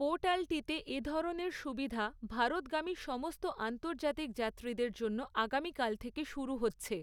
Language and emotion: Bengali, neutral